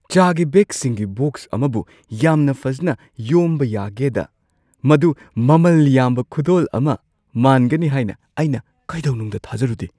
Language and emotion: Manipuri, surprised